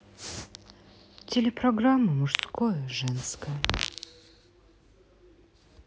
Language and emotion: Russian, sad